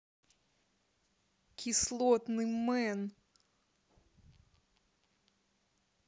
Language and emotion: Russian, angry